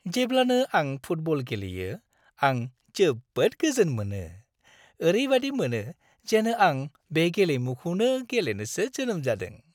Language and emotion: Bodo, happy